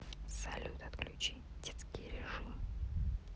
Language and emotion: Russian, neutral